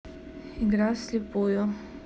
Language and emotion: Russian, neutral